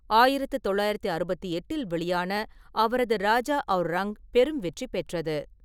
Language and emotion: Tamil, neutral